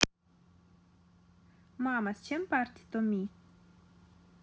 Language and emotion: Russian, neutral